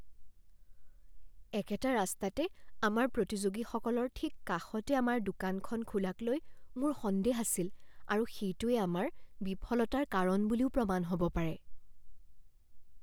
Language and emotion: Assamese, fearful